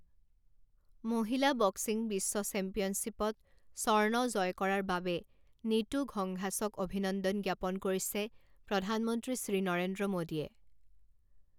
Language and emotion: Assamese, neutral